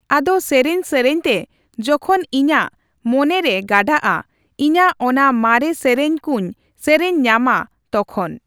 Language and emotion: Santali, neutral